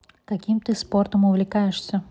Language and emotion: Russian, neutral